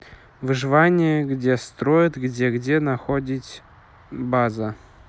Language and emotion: Russian, neutral